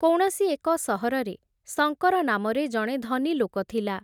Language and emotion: Odia, neutral